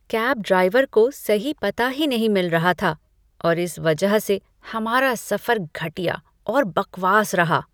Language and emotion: Hindi, disgusted